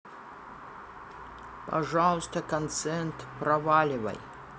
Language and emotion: Russian, neutral